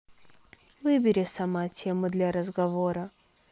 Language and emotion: Russian, neutral